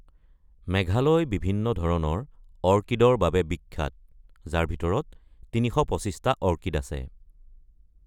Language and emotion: Assamese, neutral